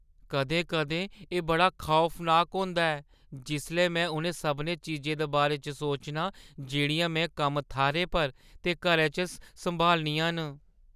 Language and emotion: Dogri, fearful